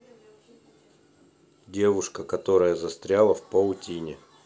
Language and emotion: Russian, neutral